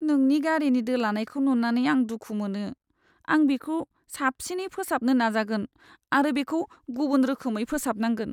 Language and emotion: Bodo, sad